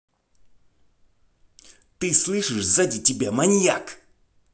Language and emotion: Russian, angry